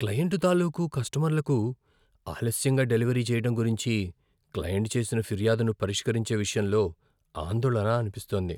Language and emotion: Telugu, fearful